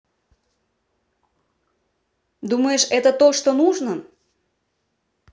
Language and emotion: Russian, neutral